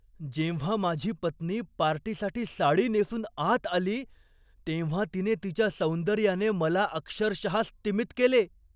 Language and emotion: Marathi, surprised